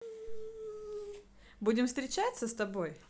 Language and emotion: Russian, positive